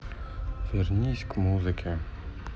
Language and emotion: Russian, sad